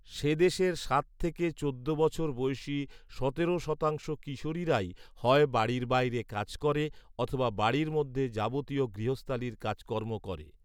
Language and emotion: Bengali, neutral